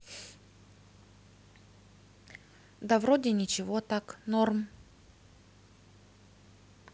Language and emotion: Russian, neutral